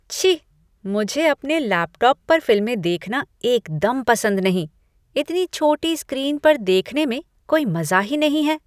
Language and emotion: Hindi, disgusted